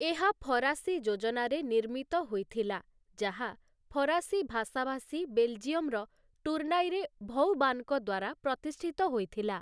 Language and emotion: Odia, neutral